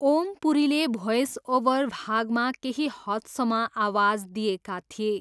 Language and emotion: Nepali, neutral